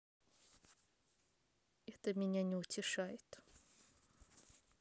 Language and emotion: Russian, neutral